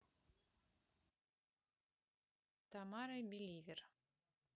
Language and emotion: Russian, neutral